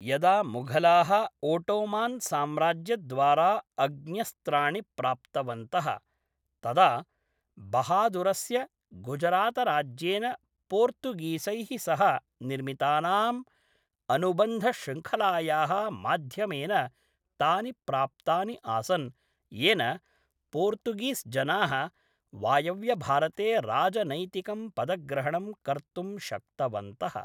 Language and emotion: Sanskrit, neutral